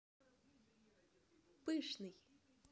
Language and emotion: Russian, neutral